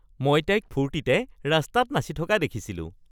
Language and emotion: Assamese, happy